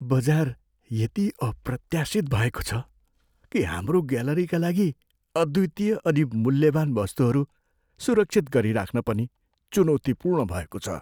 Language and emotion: Nepali, fearful